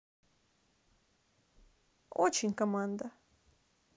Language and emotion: Russian, neutral